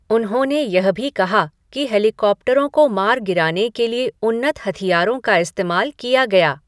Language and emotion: Hindi, neutral